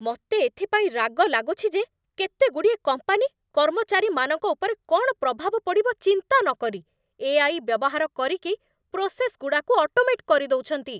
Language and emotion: Odia, angry